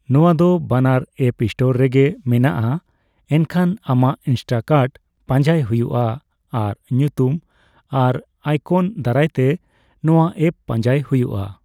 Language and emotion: Santali, neutral